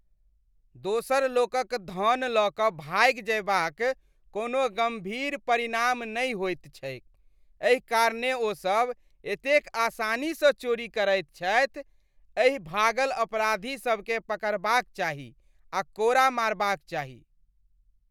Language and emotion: Maithili, disgusted